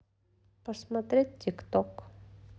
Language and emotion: Russian, neutral